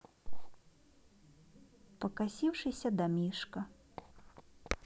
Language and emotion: Russian, sad